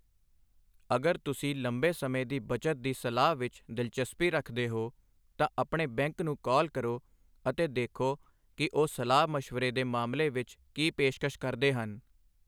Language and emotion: Punjabi, neutral